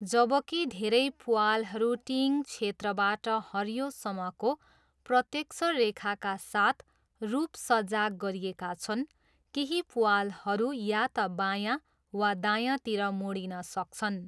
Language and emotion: Nepali, neutral